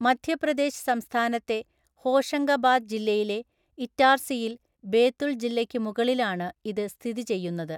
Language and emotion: Malayalam, neutral